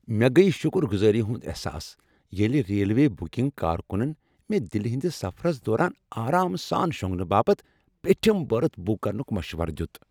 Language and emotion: Kashmiri, happy